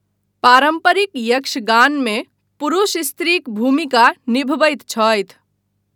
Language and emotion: Maithili, neutral